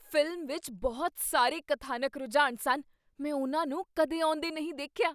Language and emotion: Punjabi, surprised